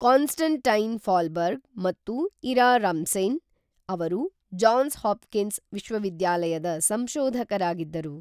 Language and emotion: Kannada, neutral